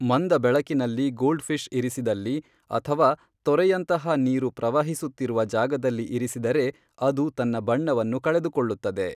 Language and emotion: Kannada, neutral